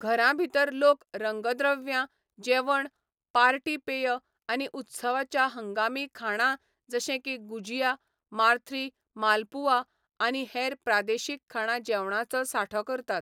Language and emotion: Goan Konkani, neutral